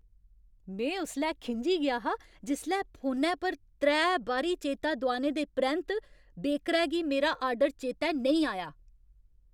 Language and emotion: Dogri, angry